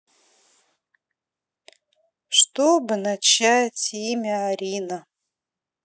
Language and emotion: Russian, sad